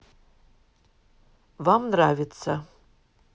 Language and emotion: Russian, neutral